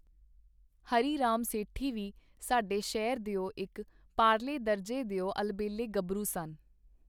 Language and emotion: Punjabi, neutral